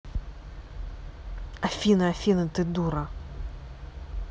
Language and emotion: Russian, angry